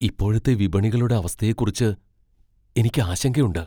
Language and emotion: Malayalam, fearful